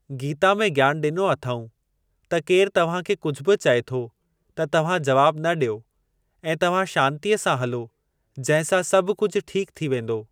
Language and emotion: Sindhi, neutral